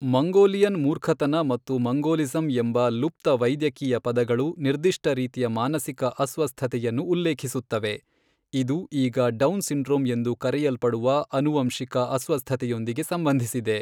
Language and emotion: Kannada, neutral